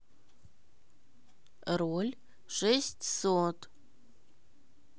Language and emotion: Russian, neutral